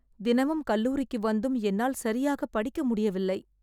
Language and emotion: Tamil, sad